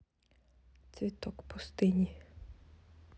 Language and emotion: Russian, neutral